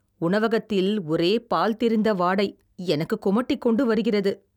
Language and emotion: Tamil, disgusted